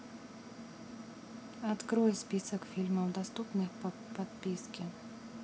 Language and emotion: Russian, neutral